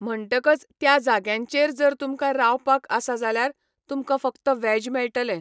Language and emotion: Goan Konkani, neutral